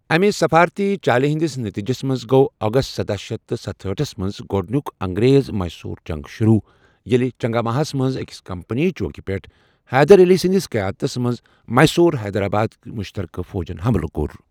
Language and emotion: Kashmiri, neutral